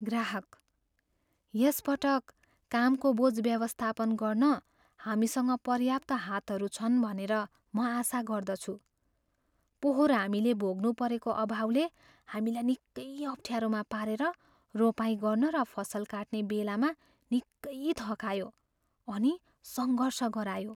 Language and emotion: Nepali, fearful